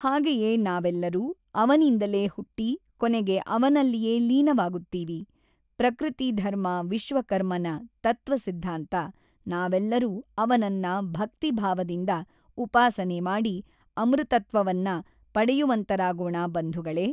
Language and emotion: Kannada, neutral